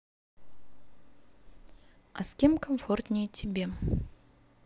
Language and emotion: Russian, neutral